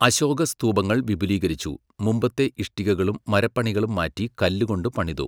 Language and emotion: Malayalam, neutral